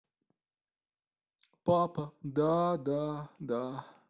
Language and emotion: Russian, sad